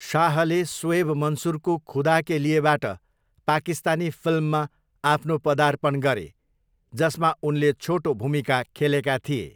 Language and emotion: Nepali, neutral